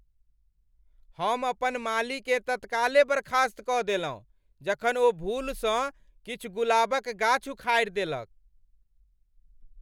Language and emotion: Maithili, angry